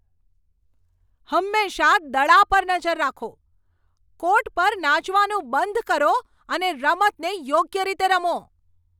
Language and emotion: Gujarati, angry